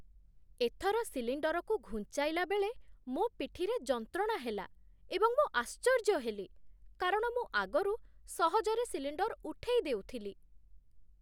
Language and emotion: Odia, surprised